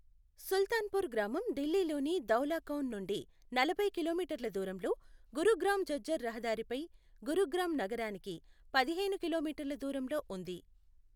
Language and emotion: Telugu, neutral